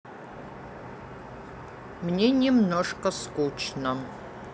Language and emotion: Russian, neutral